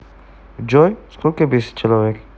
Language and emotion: Russian, neutral